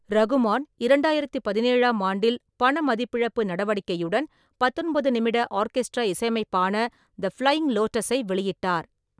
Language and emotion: Tamil, neutral